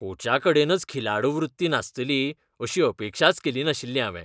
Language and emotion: Goan Konkani, disgusted